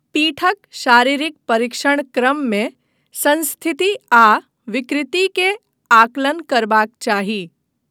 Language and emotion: Maithili, neutral